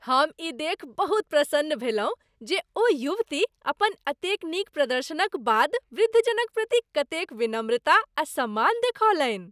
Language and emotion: Maithili, happy